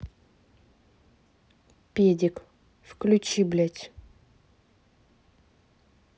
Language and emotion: Russian, angry